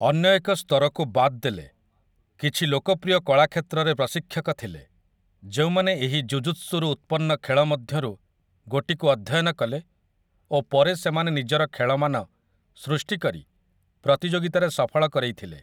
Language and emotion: Odia, neutral